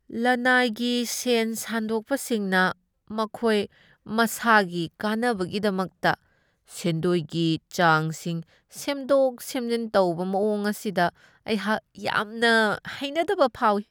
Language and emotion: Manipuri, disgusted